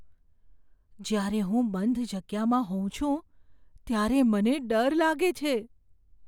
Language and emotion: Gujarati, fearful